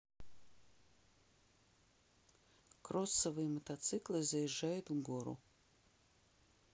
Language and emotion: Russian, neutral